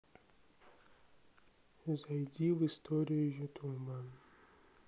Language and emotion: Russian, sad